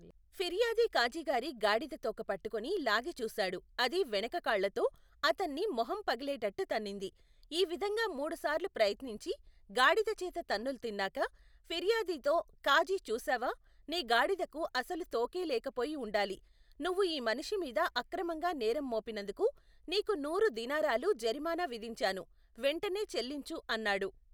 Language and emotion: Telugu, neutral